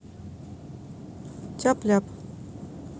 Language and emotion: Russian, neutral